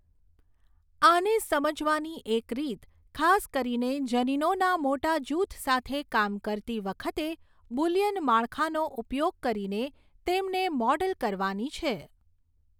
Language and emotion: Gujarati, neutral